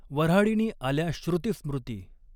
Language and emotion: Marathi, neutral